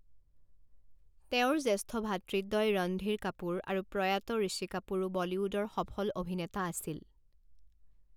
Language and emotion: Assamese, neutral